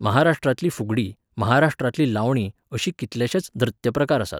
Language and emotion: Goan Konkani, neutral